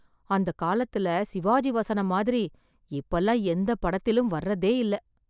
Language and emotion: Tamil, sad